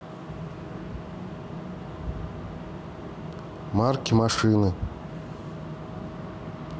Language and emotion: Russian, neutral